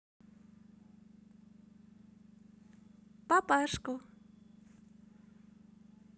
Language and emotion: Russian, positive